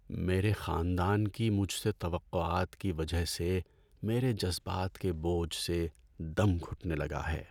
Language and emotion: Urdu, sad